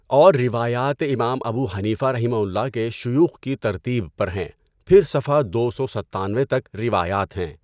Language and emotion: Urdu, neutral